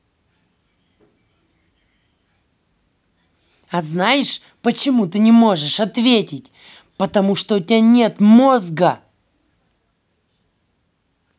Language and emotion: Russian, angry